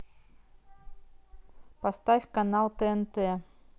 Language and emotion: Russian, neutral